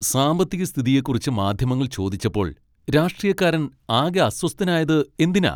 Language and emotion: Malayalam, angry